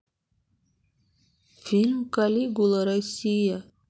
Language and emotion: Russian, sad